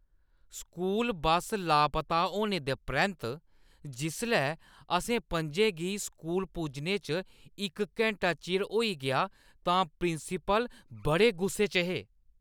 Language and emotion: Dogri, angry